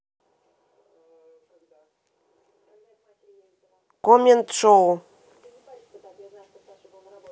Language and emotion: Russian, neutral